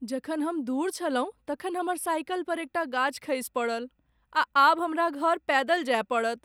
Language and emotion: Maithili, sad